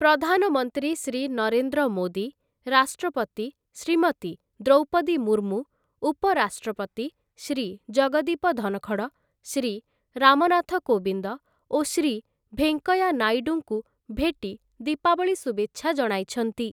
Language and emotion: Odia, neutral